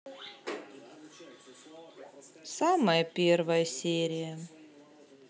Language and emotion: Russian, sad